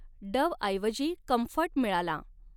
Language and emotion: Marathi, neutral